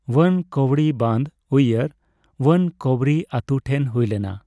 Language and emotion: Santali, neutral